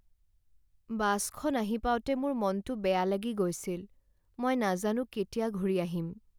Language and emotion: Assamese, sad